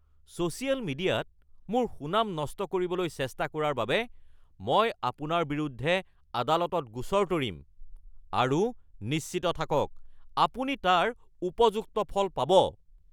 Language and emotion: Assamese, angry